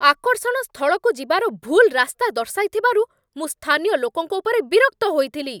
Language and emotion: Odia, angry